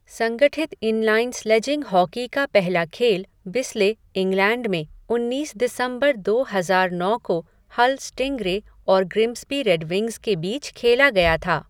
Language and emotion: Hindi, neutral